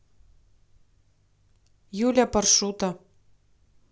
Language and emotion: Russian, neutral